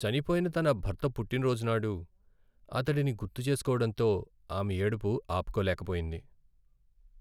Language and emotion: Telugu, sad